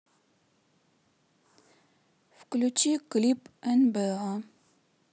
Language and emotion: Russian, neutral